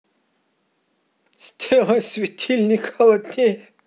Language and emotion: Russian, positive